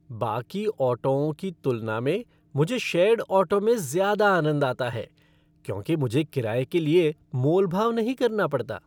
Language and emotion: Hindi, happy